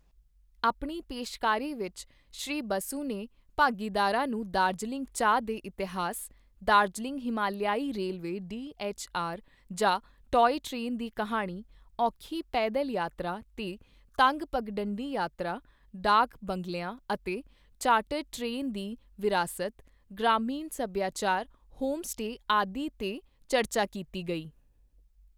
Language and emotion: Punjabi, neutral